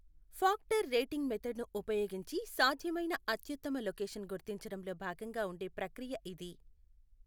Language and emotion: Telugu, neutral